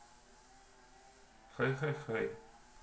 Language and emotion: Russian, neutral